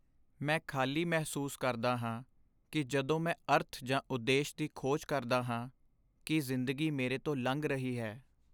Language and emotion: Punjabi, sad